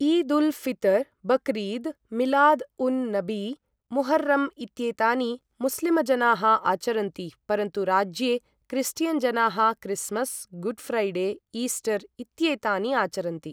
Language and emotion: Sanskrit, neutral